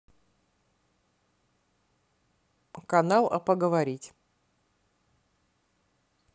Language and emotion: Russian, neutral